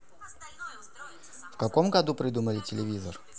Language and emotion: Russian, neutral